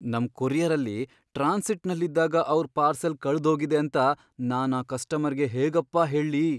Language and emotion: Kannada, fearful